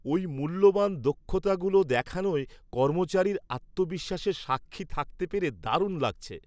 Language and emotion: Bengali, happy